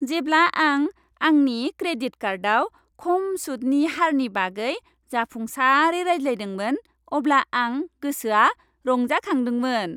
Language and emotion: Bodo, happy